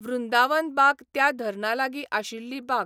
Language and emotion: Goan Konkani, neutral